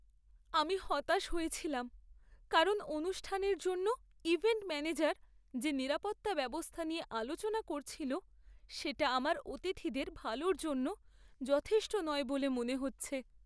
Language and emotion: Bengali, sad